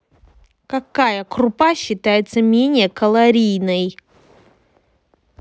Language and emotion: Russian, angry